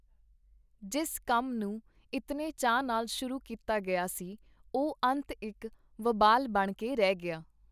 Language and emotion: Punjabi, neutral